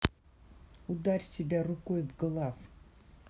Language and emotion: Russian, angry